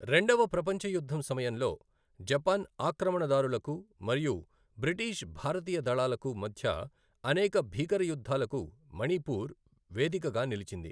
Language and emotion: Telugu, neutral